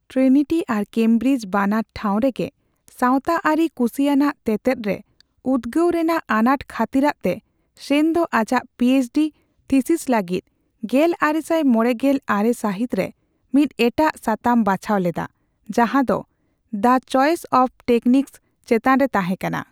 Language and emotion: Santali, neutral